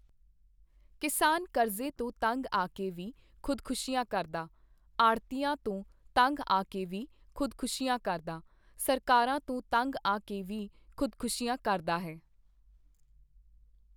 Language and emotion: Punjabi, neutral